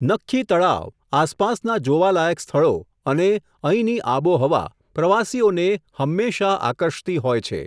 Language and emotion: Gujarati, neutral